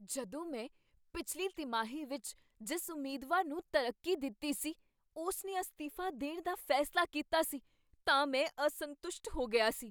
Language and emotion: Punjabi, surprised